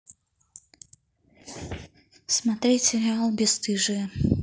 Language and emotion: Russian, neutral